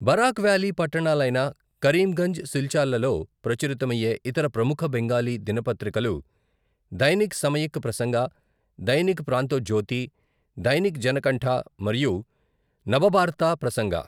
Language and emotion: Telugu, neutral